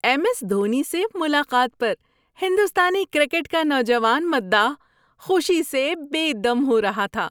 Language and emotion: Urdu, happy